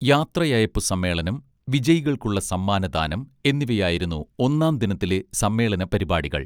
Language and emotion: Malayalam, neutral